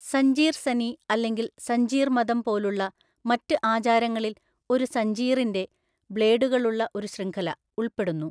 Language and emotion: Malayalam, neutral